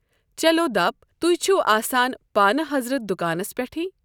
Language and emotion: Kashmiri, neutral